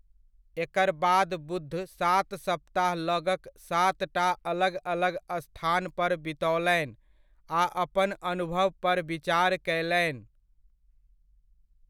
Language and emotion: Maithili, neutral